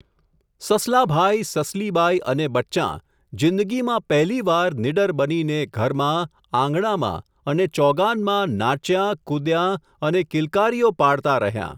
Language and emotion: Gujarati, neutral